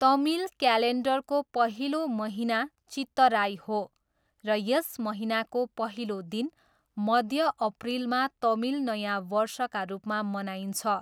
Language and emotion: Nepali, neutral